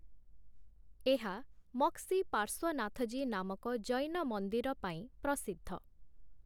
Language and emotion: Odia, neutral